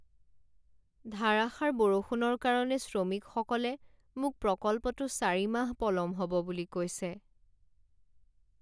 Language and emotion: Assamese, sad